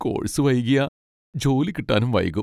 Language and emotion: Malayalam, sad